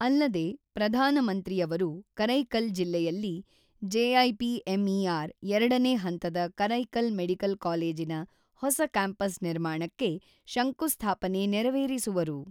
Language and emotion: Kannada, neutral